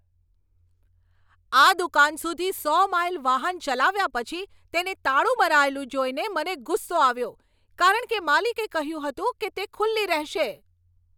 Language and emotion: Gujarati, angry